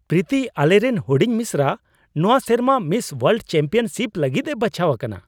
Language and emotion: Santali, surprised